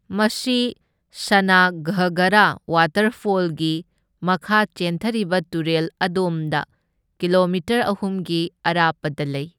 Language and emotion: Manipuri, neutral